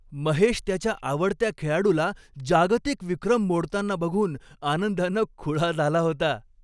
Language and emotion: Marathi, happy